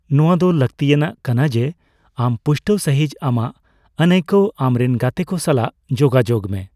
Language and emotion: Santali, neutral